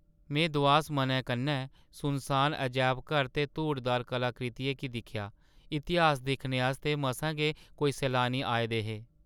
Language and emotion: Dogri, sad